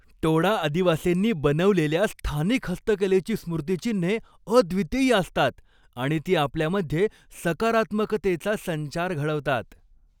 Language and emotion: Marathi, happy